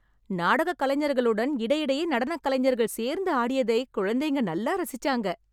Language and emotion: Tamil, happy